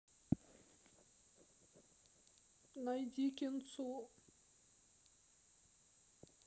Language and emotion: Russian, sad